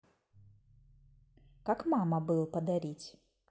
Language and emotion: Russian, neutral